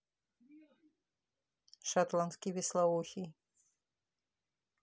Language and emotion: Russian, neutral